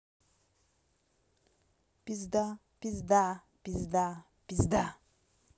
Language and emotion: Russian, angry